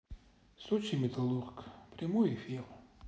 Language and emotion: Russian, sad